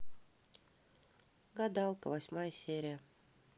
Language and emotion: Russian, neutral